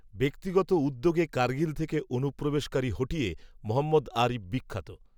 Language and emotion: Bengali, neutral